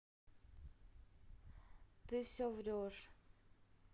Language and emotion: Russian, sad